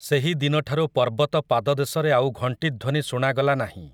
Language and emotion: Odia, neutral